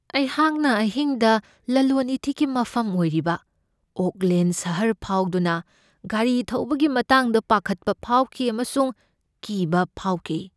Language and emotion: Manipuri, fearful